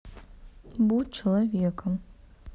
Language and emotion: Russian, neutral